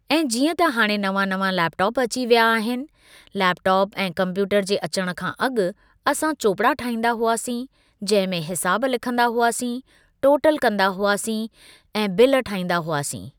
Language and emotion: Sindhi, neutral